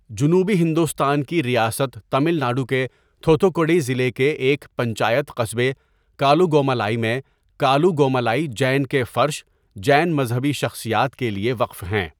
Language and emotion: Urdu, neutral